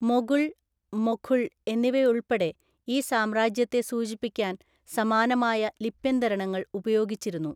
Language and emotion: Malayalam, neutral